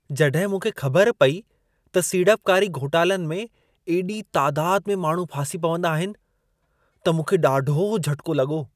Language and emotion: Sindhi, surprised